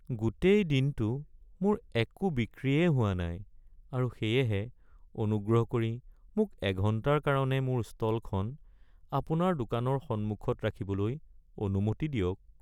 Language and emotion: Assamese, sad